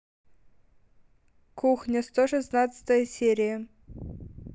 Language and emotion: Russian, neutral